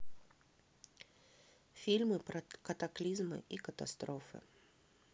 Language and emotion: Russian, neutral